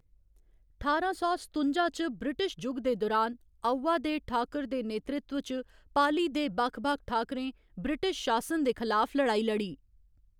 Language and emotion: Dogri, neutral